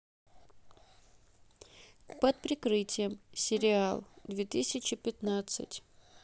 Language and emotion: Russian, neutral